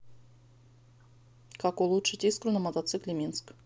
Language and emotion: Russian, neutral